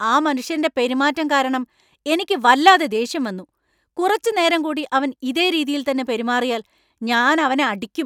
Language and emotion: Malayalam, angry